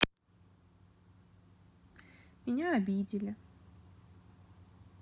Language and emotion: Russian, sad